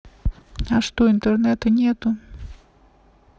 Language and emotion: Russian, neutral